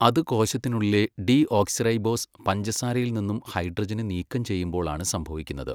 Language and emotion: Malayalam, neutral